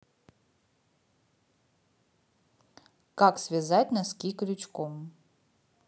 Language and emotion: Russian, neutral